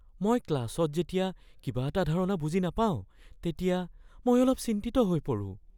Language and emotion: Assamese, fearful